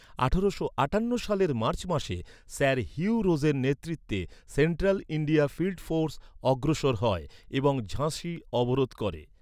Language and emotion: Bengali, neutral